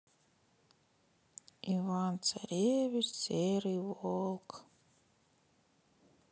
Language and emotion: Russian, sad